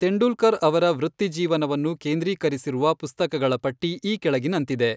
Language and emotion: Kannada, neutral